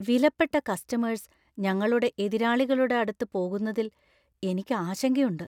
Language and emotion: Malayalam, fearful